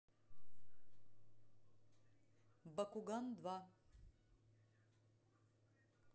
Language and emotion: Russian, neutral